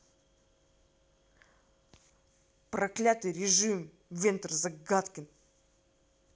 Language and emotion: Russian, angry